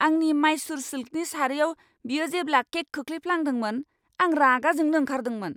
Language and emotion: Bodo, angry